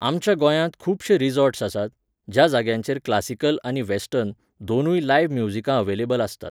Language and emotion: Goan Konkani, neutral